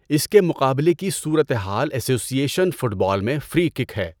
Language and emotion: Urdu, neutral